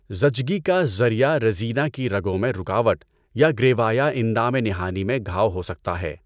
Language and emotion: Urdu, neutral